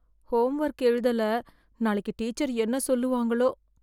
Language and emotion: Tamil, fearful